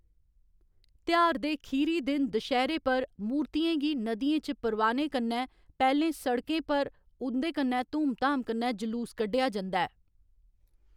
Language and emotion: Dogri, neutral